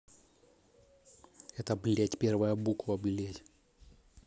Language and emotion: Russian, angry